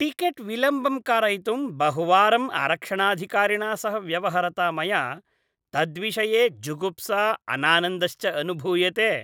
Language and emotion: Sanskrit, disgusted